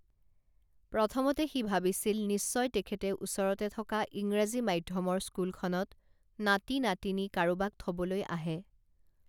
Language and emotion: Assamese, neutral